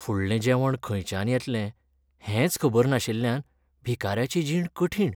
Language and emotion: Goan Konkani, sad